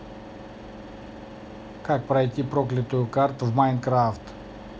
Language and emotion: Russian, neutral